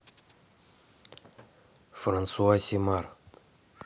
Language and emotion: Russian, neutral